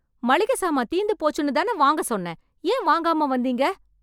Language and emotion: Tamil, angry